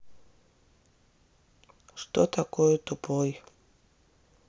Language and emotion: Russian, sad